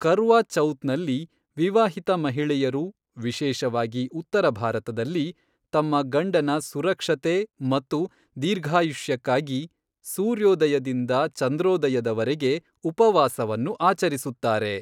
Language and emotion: Kannada, neutral